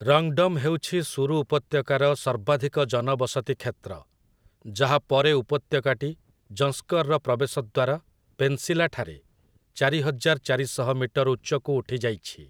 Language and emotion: Odia, neutral